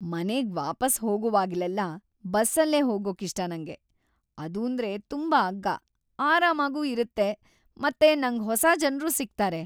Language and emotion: Kannada, happy